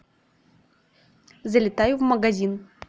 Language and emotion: Russian, neutral